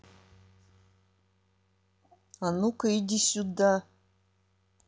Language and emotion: Russian, angry